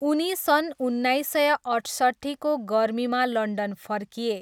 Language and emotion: Nepali, neutral